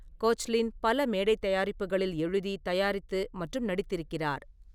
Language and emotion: Tamil, neutral